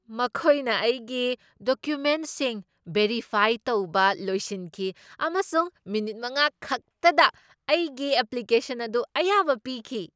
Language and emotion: Manipuri, surprised